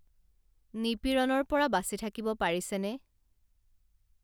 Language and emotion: Assamese, neutral